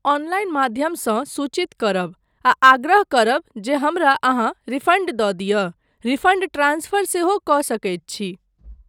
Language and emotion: Maithili, neutral